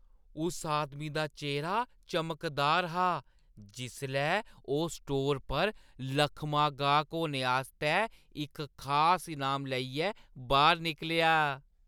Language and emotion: Dogri, happy